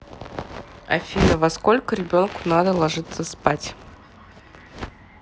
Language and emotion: Russian, neutral